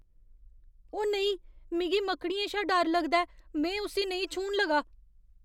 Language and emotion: Dogri, fearful